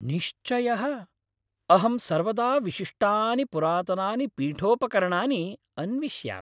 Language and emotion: Sanskrit, happy